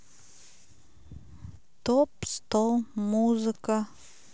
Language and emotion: Russian, neutral